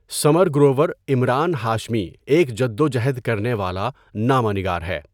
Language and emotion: Urdu, neutral